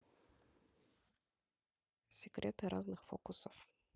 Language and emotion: Russian, neutral